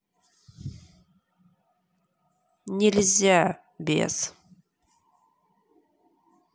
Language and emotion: Russian, angry